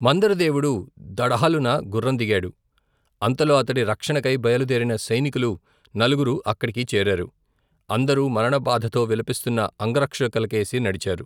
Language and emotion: Telugu, neutral